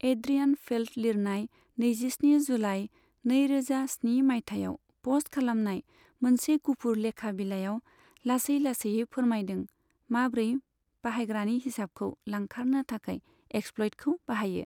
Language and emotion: Bodo, neutral